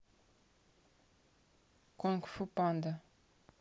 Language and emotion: Russian, neutral